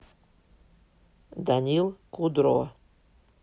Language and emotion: Russian, neutral